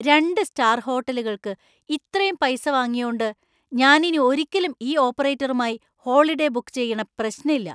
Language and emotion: Malayalam, angry